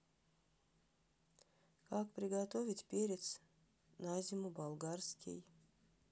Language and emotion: Russian, neutral